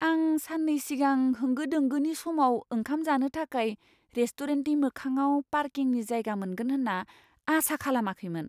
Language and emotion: Bodo, surprised